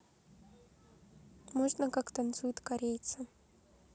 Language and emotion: Russian, neutral